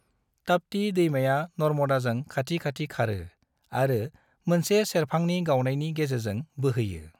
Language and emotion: Bodo, neutral